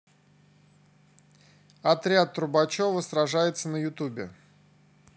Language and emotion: Russian, neutral